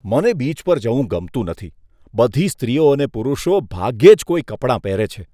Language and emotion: Gujarati, disgusted